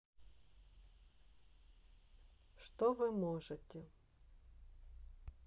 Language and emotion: Russian, neutral